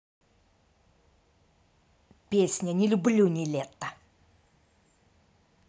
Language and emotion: Russian, angry